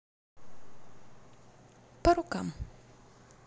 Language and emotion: Russian, neutral